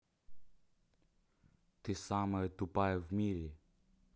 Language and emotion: Russian, neutral